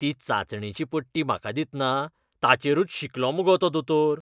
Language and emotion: Goan Konkani, disgusted